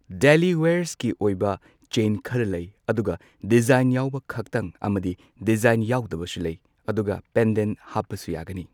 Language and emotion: Manipuri, neutral